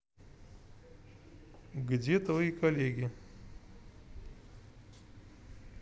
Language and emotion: Russian, neutral